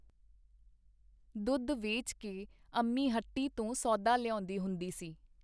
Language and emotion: Punjabi, neutral